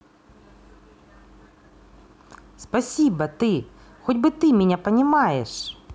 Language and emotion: Russian, positive